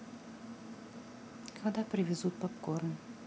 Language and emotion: Russian, neutral